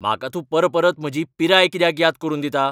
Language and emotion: Goan Konkani, angry